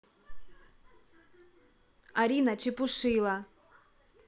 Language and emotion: Russian, angry